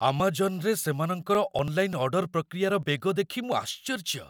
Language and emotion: Odia, surprised